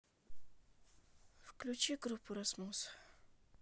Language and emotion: Russian, neutral